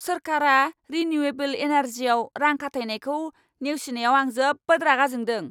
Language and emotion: Bodo, angry